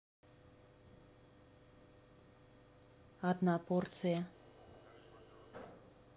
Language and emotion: Russian, neutral